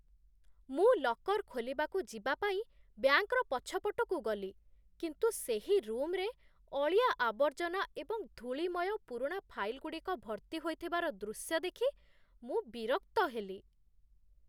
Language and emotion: Odia, disgusted